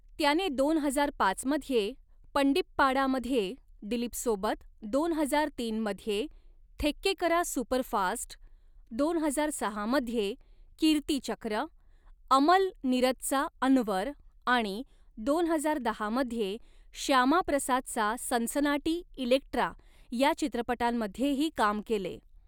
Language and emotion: Marathi, neutral